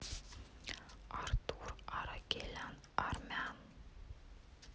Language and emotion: Russian, neutral